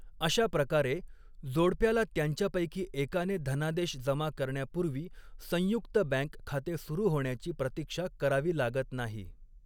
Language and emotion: Marathi, neutral